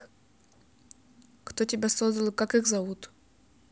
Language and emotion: Russian, neutral